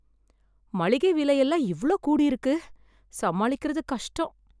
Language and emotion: Tamil, sad